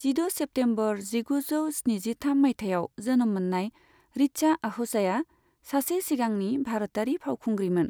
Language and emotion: Bodo, neutral